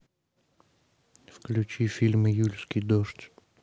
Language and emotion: Russian, neutral